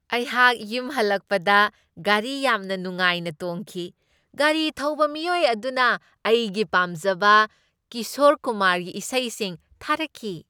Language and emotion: Manipuri, happy